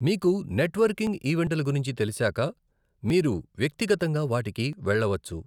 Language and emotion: Telugu, neutral